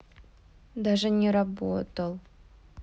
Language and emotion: Russian, sad